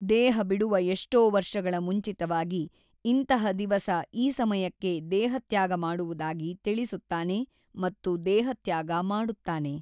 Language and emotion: Kannada, neutral